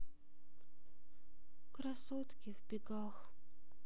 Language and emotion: Russian, sad